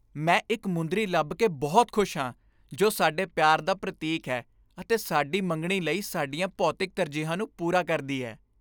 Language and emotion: Punjabi, happy